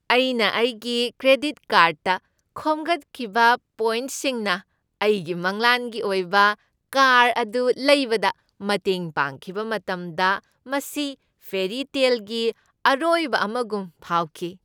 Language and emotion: Manipuri, happy